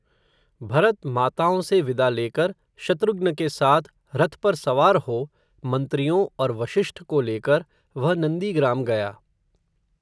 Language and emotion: Hindi, neutral